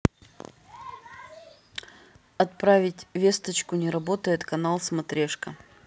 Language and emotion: Russian, neutral